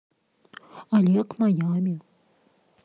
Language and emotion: Russian, neutral